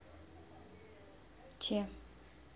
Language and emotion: Russian, neutral